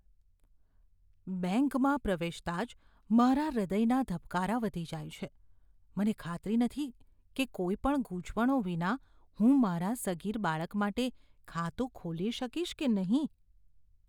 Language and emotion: Gujarati, fearful